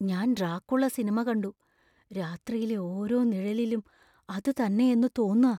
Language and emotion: Malayalam, fearful